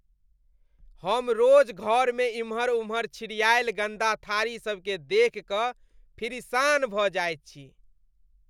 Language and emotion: Maithili, disgusted